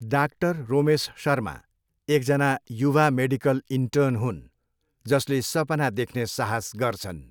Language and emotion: Nepali, neutral